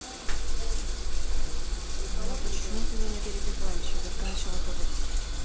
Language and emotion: Russian, neutral